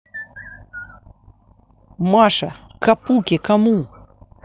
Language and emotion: Russian, angry